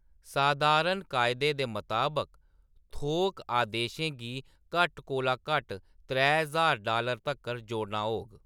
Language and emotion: Dogri, neutral